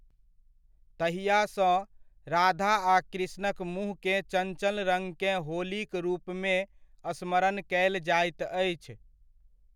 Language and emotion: Maithili, neutral